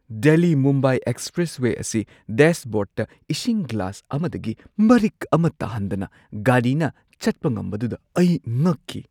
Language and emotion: Manipuri, surprised